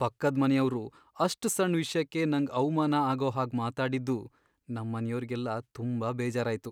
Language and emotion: Kannada, sad